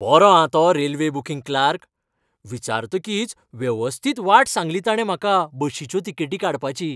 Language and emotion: Goan Konkani, happy